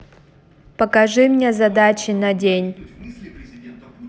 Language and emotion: Russian, neutral